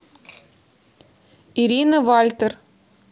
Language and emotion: Russian, neutral